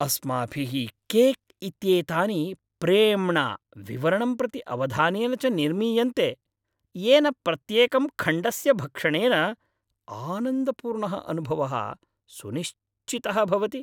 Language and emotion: Sanskrit, happy